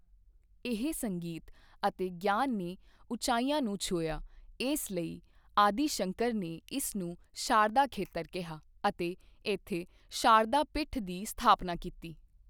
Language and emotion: Punjabi, neutral